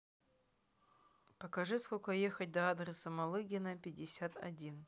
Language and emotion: Russian, neutral